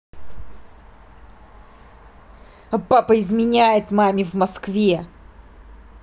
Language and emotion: Russian, angry